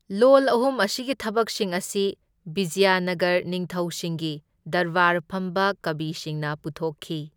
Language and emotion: Manipuri, neutral